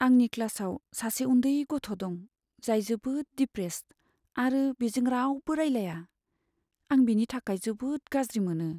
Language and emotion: Bodo, sad